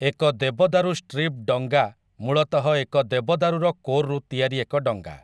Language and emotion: Odia, neutral